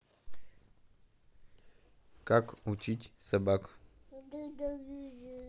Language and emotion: Russian, neutral